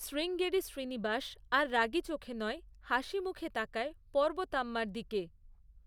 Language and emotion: Bengali, neutral